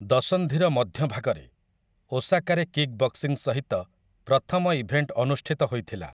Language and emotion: Odia, neutral